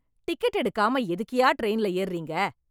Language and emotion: Tamil, angry